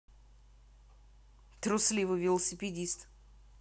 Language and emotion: Russian, angry